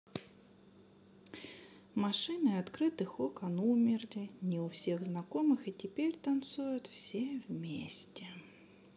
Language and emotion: Russian, sad